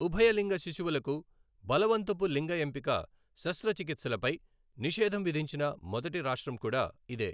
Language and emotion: Telugu, neutral